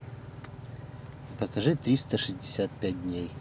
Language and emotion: Russian, neutral